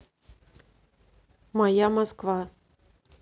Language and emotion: Russian, neutral